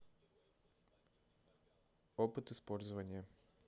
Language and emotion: Russian, neutral